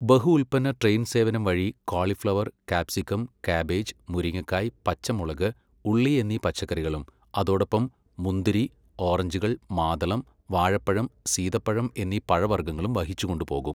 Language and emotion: Malayalam, neutral